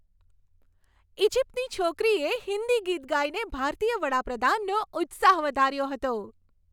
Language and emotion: Gujarati, happy